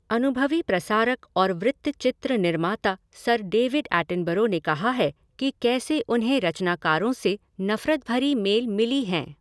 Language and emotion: Hindi, neutral